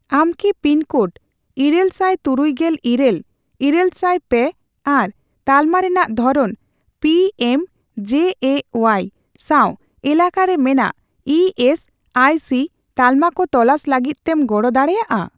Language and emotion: Santali, neutral